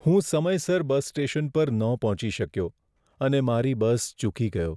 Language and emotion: Gujarati, sad